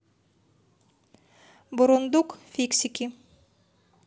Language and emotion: Russian, neutral